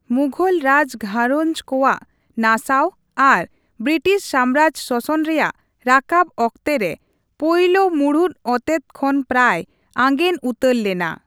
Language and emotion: Santali, neutral